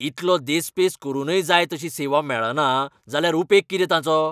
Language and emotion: Goan Konkani, angry